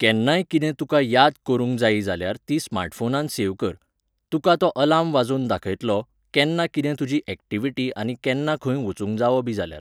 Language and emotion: Goan Konkani, neutral